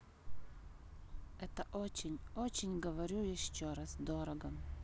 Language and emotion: Russian, sad